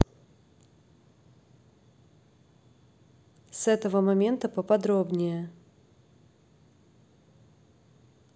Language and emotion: Russian, neutral